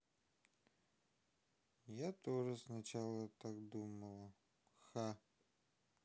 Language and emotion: Russian, sad